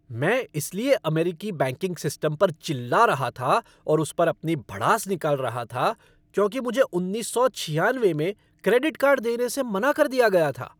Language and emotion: Hindi, angry